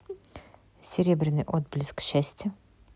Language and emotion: Russian, neutral